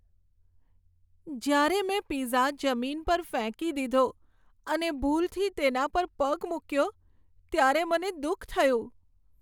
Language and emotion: Gujarati, sad